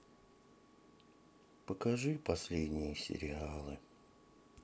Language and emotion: Russian, sad